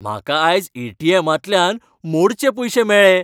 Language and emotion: Goan Konkani, happy